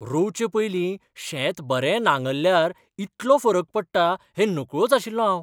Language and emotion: Goan Konkani, surprised